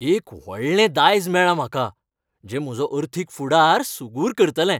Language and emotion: Goan Konkani, happy